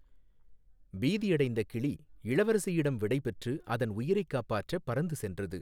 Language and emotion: Tamil, neutral